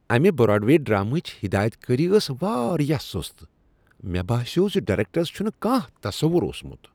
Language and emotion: Kashmiri, disgusted